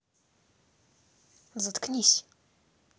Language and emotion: Russian, angry